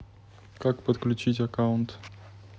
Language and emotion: Russian, neutral